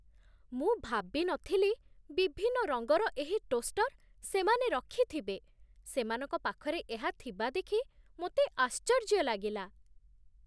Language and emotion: Odia, surprised